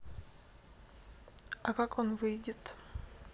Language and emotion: Russian, neutral